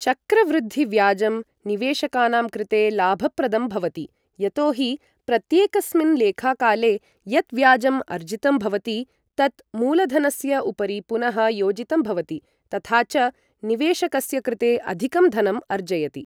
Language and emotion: Sanskrit, neutral